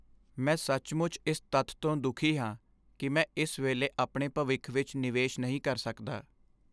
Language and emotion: Punjabi, sad